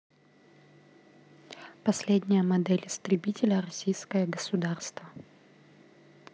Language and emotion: Russian, neutral